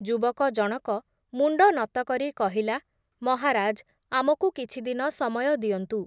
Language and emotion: Odia, neutral